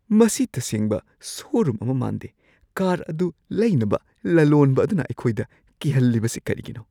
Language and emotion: Manipuri, fearful